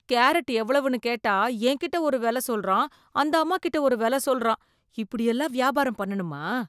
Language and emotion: Tamil, disgusted